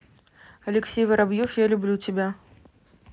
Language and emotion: Russian, neutral